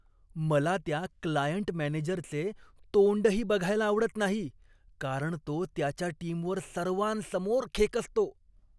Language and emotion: Marathi, disgusted